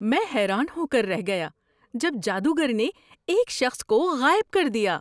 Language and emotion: Urdu, surprised